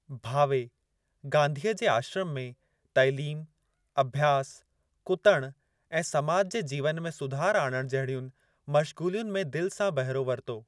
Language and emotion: Sindhi, neutral